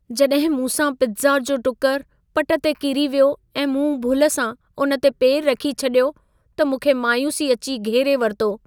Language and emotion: Sindhi, sad